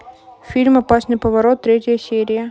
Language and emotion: Russian, neutral